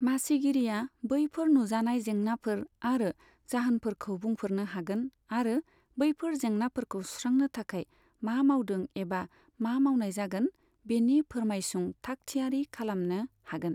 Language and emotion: Bodo, neutral